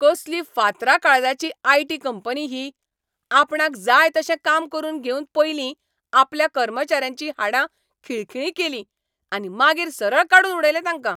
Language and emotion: Goan Konkani, angry